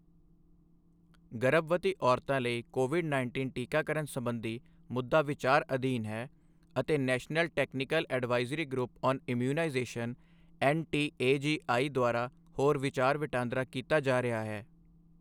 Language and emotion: Punjabi, neutral